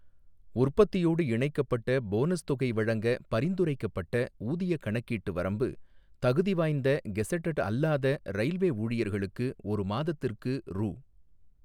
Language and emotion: Tamil, neutral